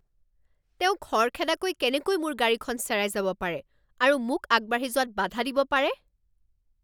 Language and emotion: Assamese, angry